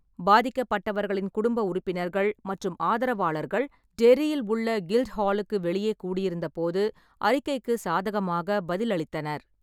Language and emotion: Tamil, neutral